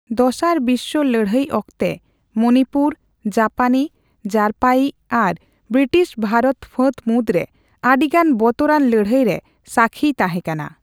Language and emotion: Santali, neutral